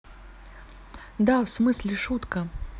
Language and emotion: Russian, neutral